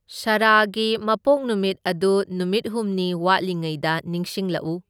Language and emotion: Manipuri, neutral